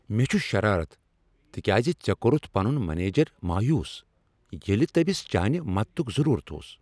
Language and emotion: Kashmiri, angry